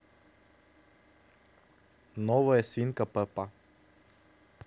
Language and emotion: Russian, neutral